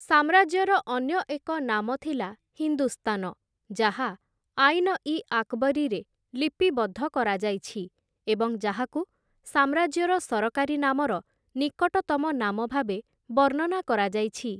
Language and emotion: Odia, neutral